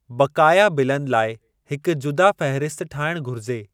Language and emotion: Sindhi, neutral